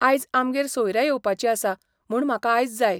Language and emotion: Goan Konkani, neutral